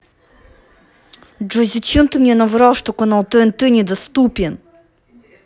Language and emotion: Russian, angry